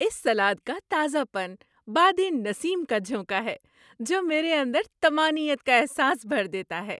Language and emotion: Urdu, happy